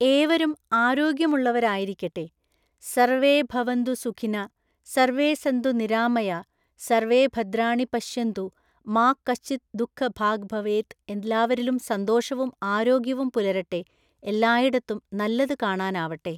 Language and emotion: Malayalam, neutral